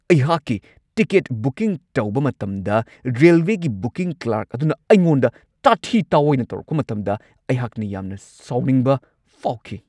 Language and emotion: Manipuri, angry